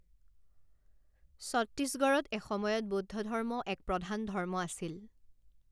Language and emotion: Assamese, neutral